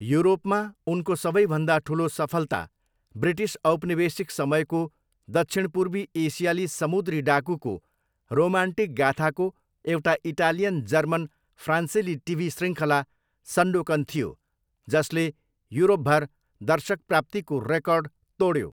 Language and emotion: Nepali, neutral